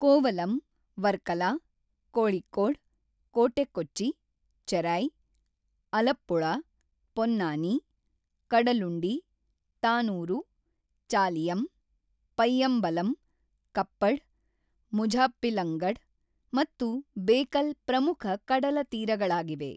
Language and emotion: Kannada, neutral